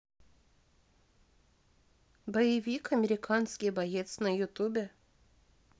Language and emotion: Russian, neutral